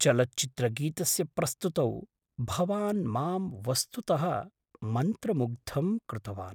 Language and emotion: Sanskrit, surprised